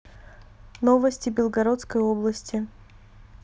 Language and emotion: Russian, neutral